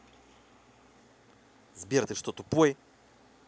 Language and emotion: Russian, angry